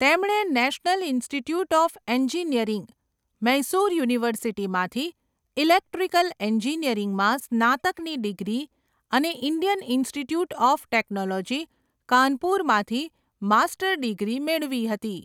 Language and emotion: Gujarati, neutral